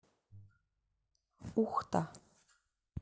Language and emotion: Russian, neutral